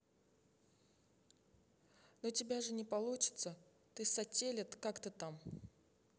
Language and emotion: Russian, neutral